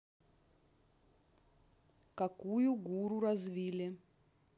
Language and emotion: Russian, neutral